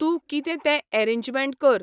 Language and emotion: Goan Konkani, neutral